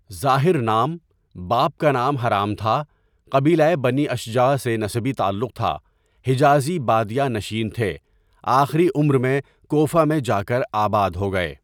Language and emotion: Urdu, neutral